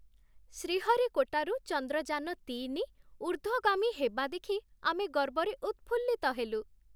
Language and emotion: Odia, happy